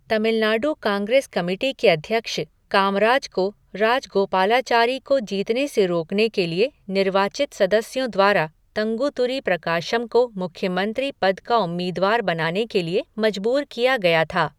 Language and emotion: Hindi, neutral